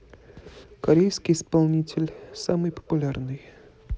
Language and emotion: Russian, neutral